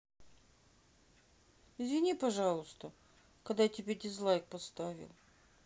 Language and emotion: Russian, sad